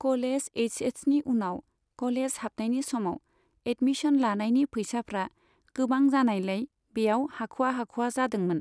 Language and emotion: Bodo, neutral